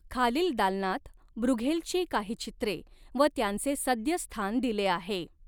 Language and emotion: Marathi, neutral